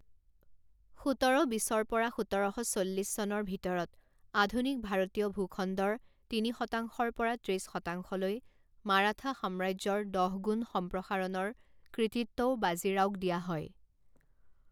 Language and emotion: Assamese, neutral